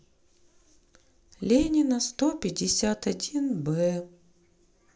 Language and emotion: Russian, sad